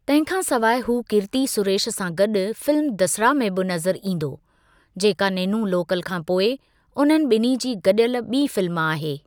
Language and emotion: Sindhi, neutral